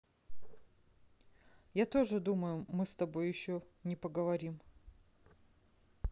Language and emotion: Russian, neutral